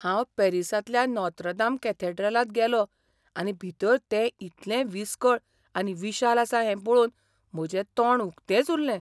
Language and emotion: Goan Konkani, surprised